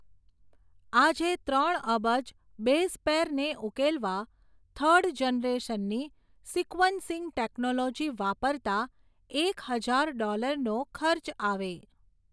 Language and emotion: Gujarati, neutral